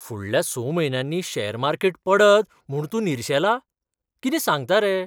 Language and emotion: Goan Konkani, surprised